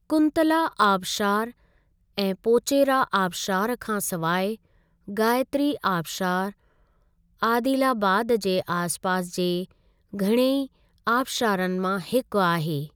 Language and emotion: Sindhi, neutral